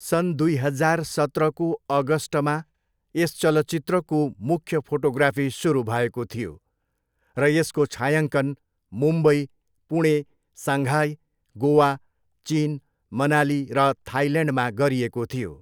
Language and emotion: Nepali, neutral